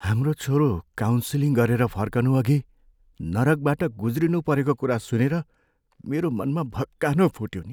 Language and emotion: Nepali, sad